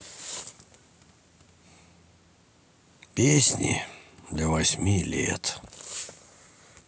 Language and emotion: Russian, sad